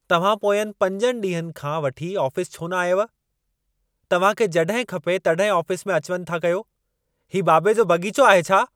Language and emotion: Sindhi, angry